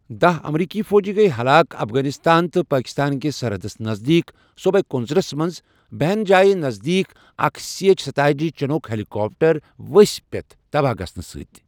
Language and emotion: Kashmiri, neutral